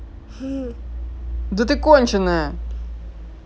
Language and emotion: Russian, angry